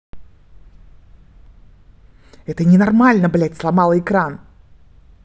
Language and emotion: Russian, angry